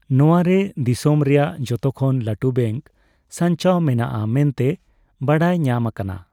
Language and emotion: Santali, neutral